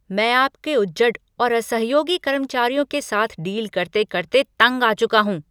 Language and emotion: Hindi, angry